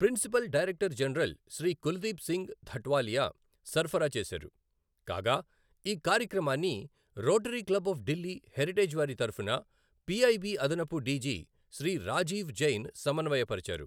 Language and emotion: Telugu, neutral